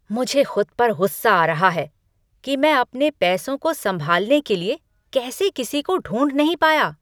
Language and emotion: Hindi, angry